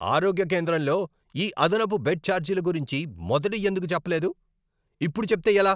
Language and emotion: Telugu, angry